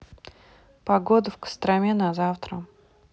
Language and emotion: Russian, neutral